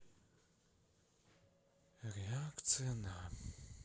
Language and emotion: Russian, sad